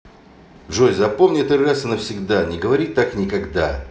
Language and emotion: Russian, angry